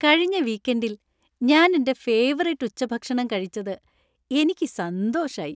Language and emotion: Malayalam, happy